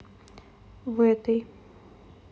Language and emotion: Russian, neutral